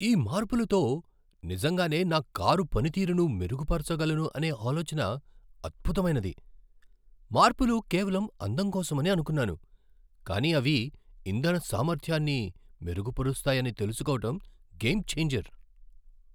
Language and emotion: Telugu, surprised